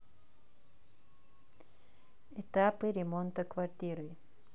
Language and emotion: Russian, neutral